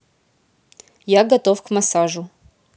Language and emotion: Russian, neutral